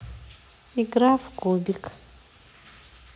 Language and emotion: Russian, neutral